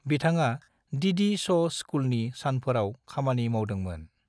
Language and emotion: Bodo, neutral